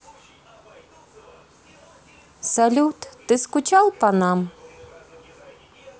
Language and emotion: Russian, neutral